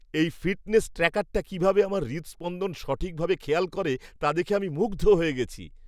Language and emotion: Bengali, surprised